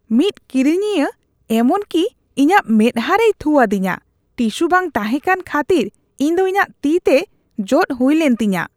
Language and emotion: Santali, disgusted